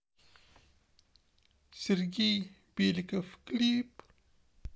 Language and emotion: Russian, sad